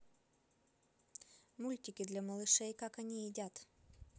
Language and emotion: Russian, neutral